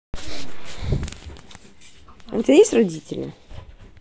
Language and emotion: Russian, neutral